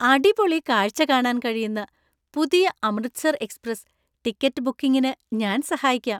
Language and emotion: Malayalam, happy